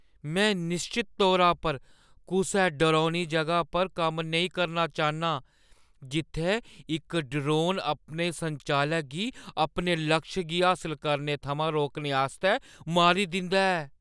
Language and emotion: Dogri, fearful